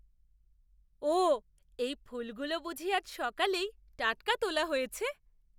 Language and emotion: Bengali, surprised